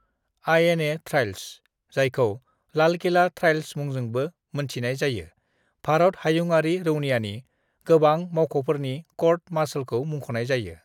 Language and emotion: Bodo, neutral